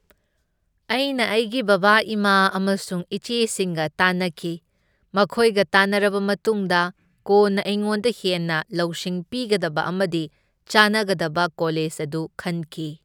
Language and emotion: Manipuri, neutral